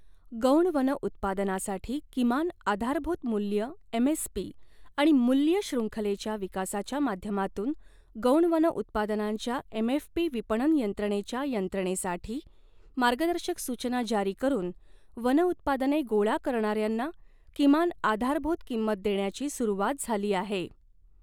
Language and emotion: Marathi, neutral